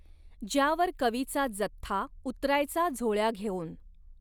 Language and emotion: Marathi, neutral